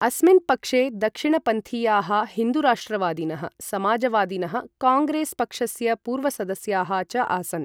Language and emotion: Sanskrit, neutral